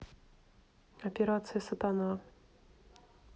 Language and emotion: Russian, neutral